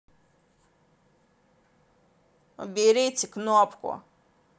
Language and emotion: Russian, angry